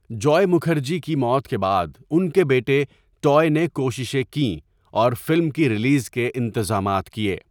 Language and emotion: Urdu, neutral